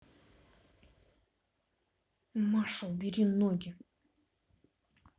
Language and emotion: Russian, angry